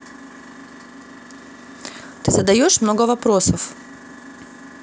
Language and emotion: Russian, angry